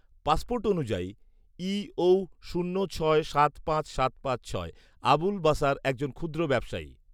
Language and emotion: Bengali, neutral